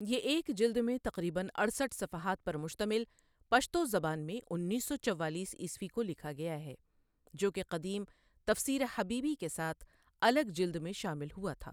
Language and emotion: Urdu, neutral